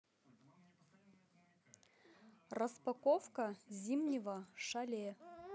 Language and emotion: Russian, neutral